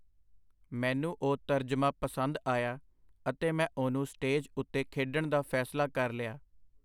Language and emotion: Punjabi, neutral